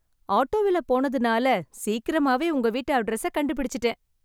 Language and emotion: Tamil, happy